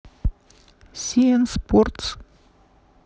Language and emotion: Russian, neutral